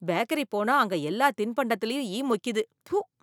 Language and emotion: Tamil, disgusted